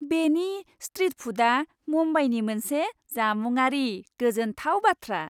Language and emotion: Bodo, happy